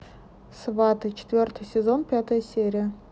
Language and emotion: Russian, neutral